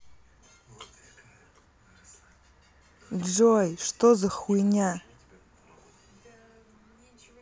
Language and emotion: Russian, angry